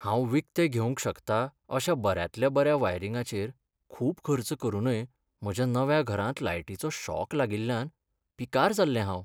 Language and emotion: Goan Konkani, sad